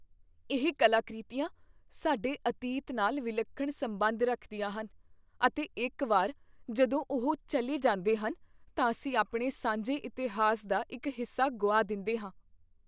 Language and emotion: Punjabi, fearful